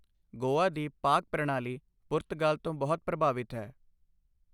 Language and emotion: Punjabi, neutral